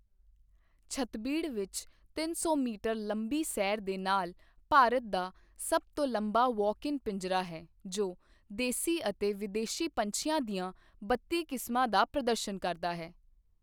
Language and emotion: Punjabi, neutral